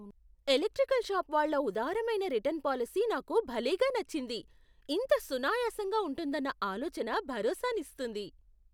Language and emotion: Telugu, surprised